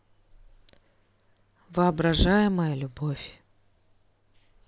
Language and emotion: Russian, neutral